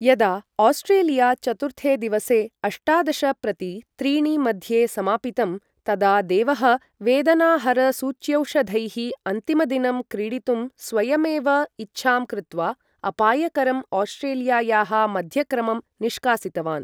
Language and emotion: Sanskrit, neutral